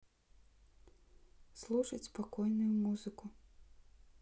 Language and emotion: Russian, neutral